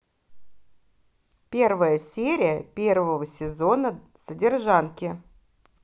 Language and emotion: Russian, positive